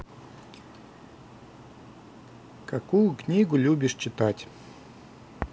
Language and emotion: Russian, neutral